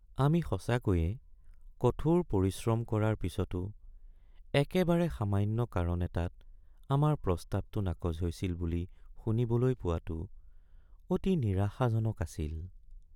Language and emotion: Assamese, sad